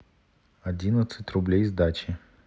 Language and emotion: Russian, neutral